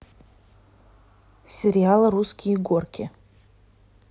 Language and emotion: Russian, neutral